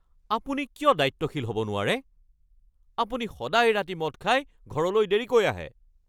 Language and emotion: Assamese, angry